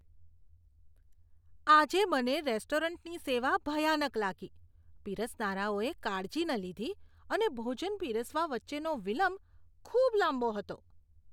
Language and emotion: Gujarati, disgusted